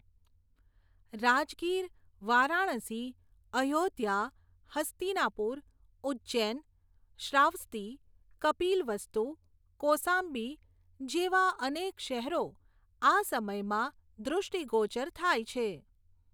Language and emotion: Gujarati, neutral